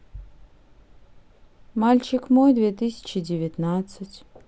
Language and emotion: Russian, neutral